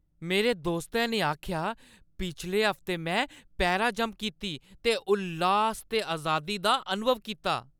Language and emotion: Dogri, happy